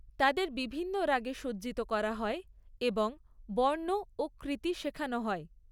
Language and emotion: Bengali, neutral